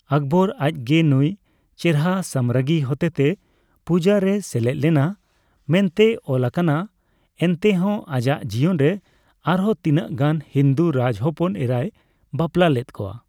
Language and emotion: Santali, neutral